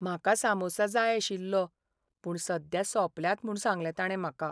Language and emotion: Goan Konkani, sad